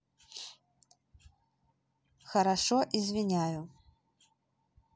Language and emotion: Russian, neutral